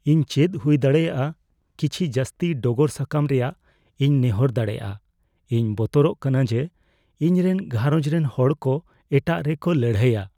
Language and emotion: Santali, fearful